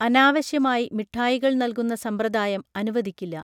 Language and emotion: Malayalam, neutral